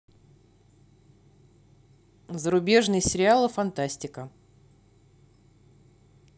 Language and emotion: Russian, neutral